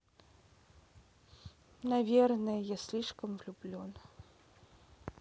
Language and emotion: Russian, sad